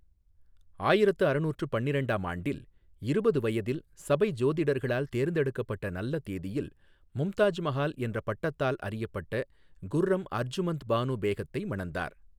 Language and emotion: Tamil, neutral